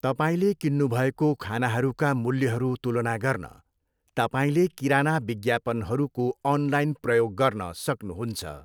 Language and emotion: Nepali, neutral